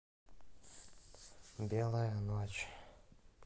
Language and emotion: Russian, sad